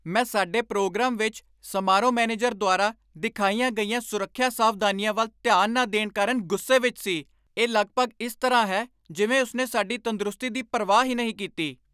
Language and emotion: Punjabi, angry